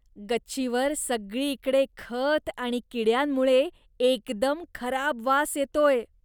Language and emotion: Marathi, disgusted